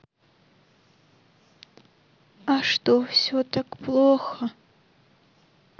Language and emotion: Russian, sad